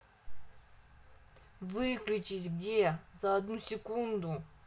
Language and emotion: Russian, angry